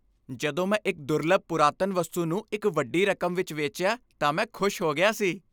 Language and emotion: Punjabi, happy